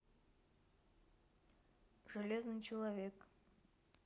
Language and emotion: Russian, neutral